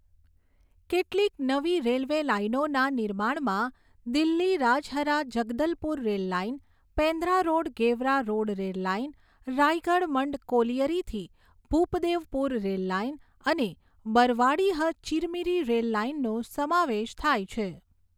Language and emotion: Gujarati, neutral